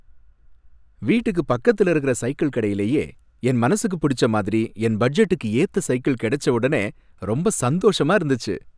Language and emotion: Tamil, happy